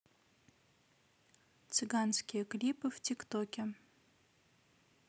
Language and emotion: Russian, neutral